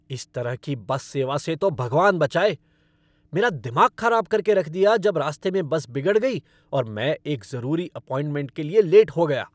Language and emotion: Hindi, angry